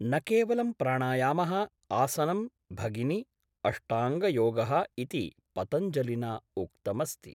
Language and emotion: Sanskrit, neutral